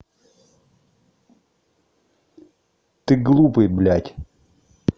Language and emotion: Russian, angry